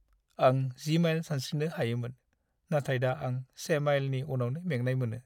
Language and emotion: Bodo, sad